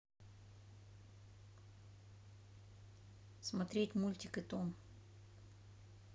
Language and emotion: Russian, neutral